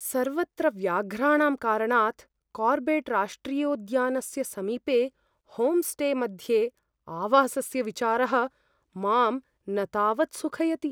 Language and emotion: Sanskrit, fearful